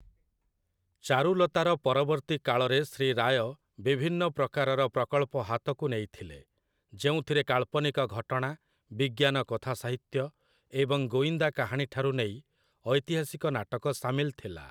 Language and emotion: Odia, neutral